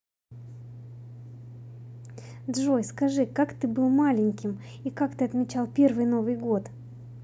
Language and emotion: Russian, positive